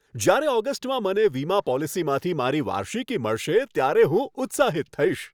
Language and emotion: Gujarati, happy